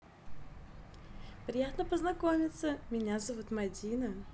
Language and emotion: Russian, positive